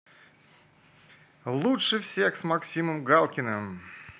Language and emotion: Russian, positive